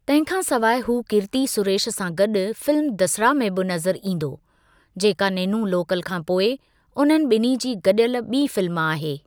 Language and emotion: Sindhi, neutral